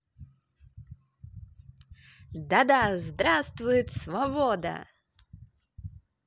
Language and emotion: Russian, positive